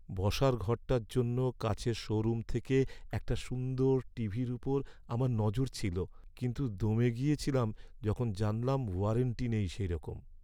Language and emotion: Bengali, sad